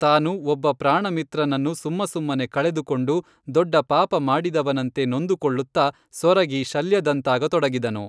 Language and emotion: Kannada, neutral